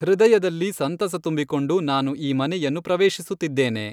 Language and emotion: Kannada, neutral